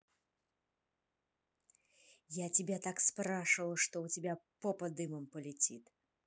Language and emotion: Russian, angry